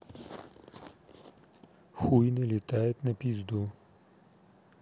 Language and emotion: Russian, neutral